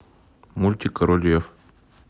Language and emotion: Russian, neutral